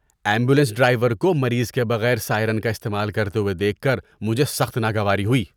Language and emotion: Urdu, disgusted